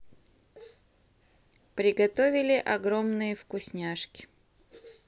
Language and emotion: Russian, neutral